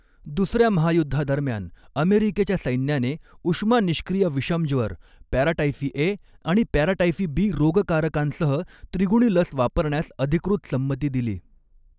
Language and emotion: Marathi, neutral